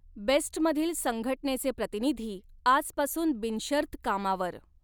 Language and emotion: Marathi, neutral